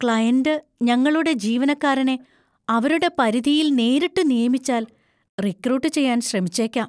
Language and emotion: Malayalam, fearful